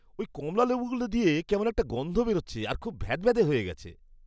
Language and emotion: Bengali, disgusted